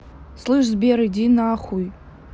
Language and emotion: Russian, angry